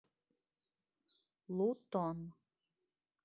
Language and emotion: Russian, neutral